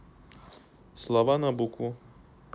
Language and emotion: Russian, neutral